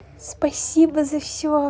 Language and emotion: Russian, positive